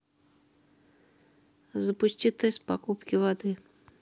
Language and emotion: Russian, neutral